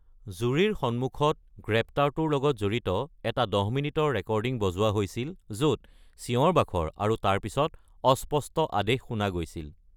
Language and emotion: Assamese, neutral